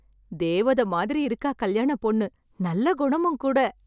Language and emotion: Tamil, happy